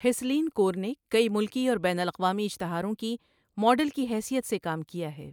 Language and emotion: Urdu, neutral